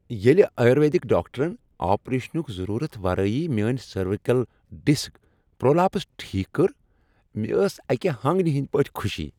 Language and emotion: Kashmiri, happy